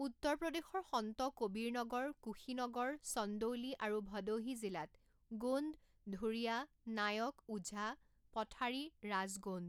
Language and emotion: Assamese, neutral